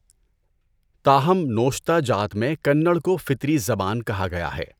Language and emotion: Urdu, neutral